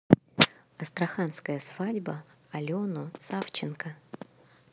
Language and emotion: Russian, neutral